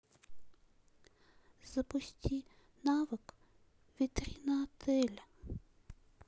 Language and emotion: Russian, sad